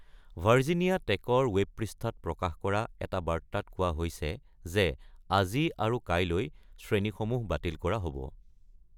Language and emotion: Assamese, neutral